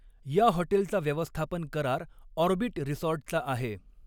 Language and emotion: Marathi, neutral